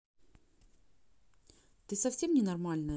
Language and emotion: Russian, angry